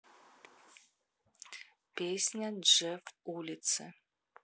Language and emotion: Russian, neutral